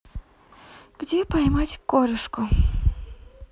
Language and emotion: Russian, sad